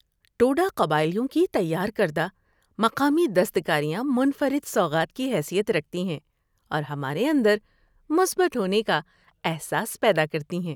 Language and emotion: Urdu, happy